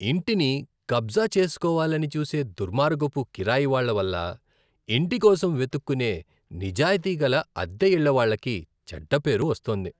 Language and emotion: Telugu, disgusted